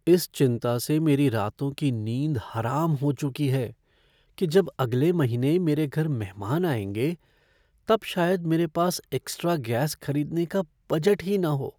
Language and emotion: Hindi, fearful